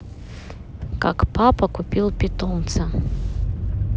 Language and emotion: Russian, neutral